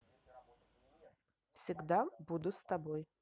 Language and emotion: Russian, positive